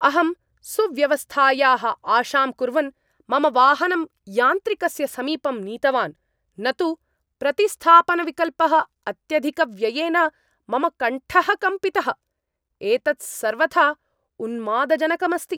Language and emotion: Sanskrit, angry